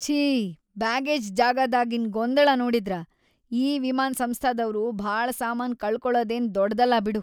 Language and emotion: Kannada, disgusted